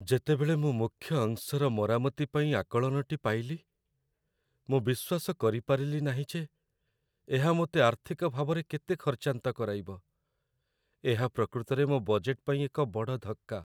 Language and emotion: Odia, sad